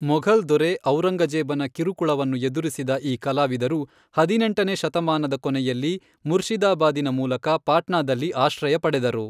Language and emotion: Kannada, neutral